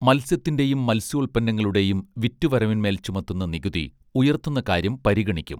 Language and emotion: Malayalam, neutral